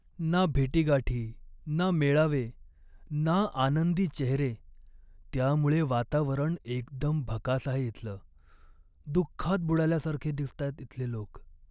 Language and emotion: Marathi, sad